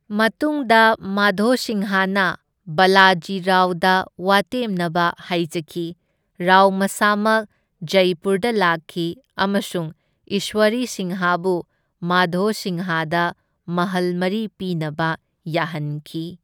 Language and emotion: Manipuri, neutral